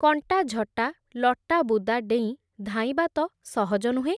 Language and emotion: Odia, neutral